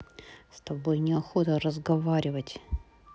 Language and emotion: Russian, angry